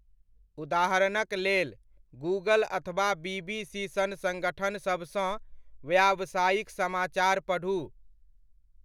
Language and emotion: Maithili, neutral